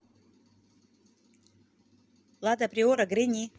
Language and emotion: Russian, neutral